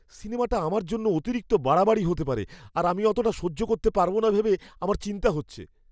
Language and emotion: Bengali, fearful